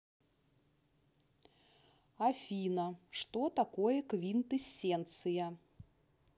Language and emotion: Russian, neutral